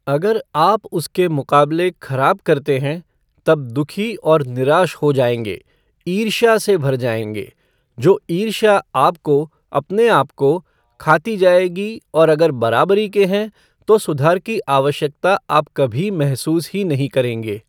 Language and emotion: Hindi, neutral